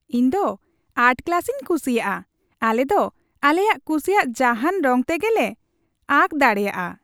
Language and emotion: Santali, happy